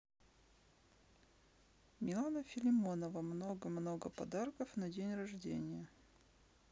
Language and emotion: Russian, neutral